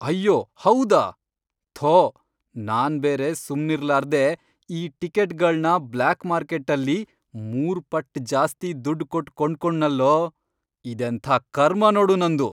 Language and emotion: Kannada, angry